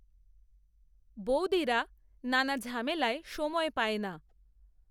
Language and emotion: Bengali, neutral